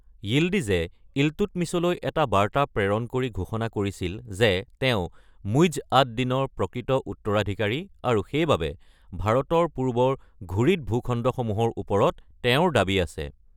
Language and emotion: Assamese, neutral